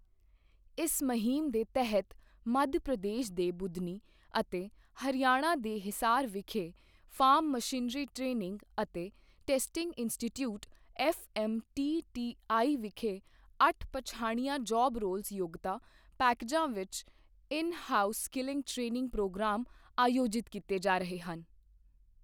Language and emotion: Punjabi, neutral